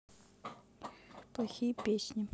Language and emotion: Russian, neutral